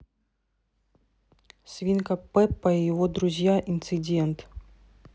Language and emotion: Russian, neutral